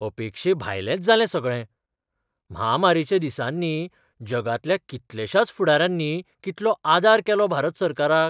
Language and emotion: Goan Konkani, surprised